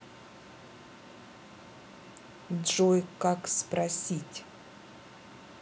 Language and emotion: Russian, neutral